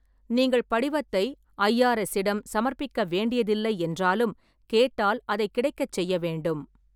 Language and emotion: Tamil, neutral